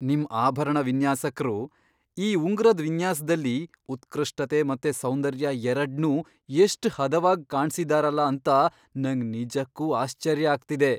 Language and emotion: Kannada, surprised